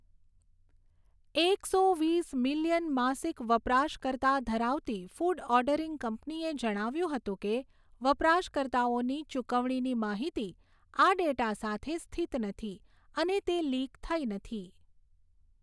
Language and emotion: Gujarati, neutral